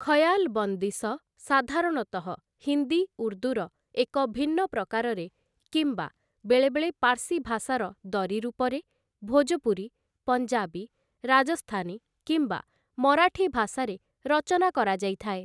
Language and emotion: Odia, neutral